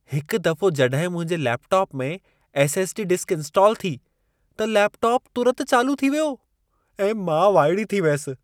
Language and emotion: Sindhi, surprised